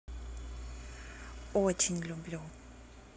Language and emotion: Russian, positive